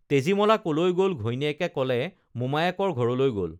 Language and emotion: Assamese, neutral